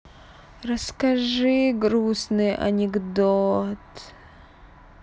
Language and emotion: Russian, sad